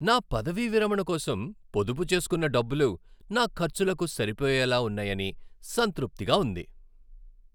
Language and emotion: Telugu, happy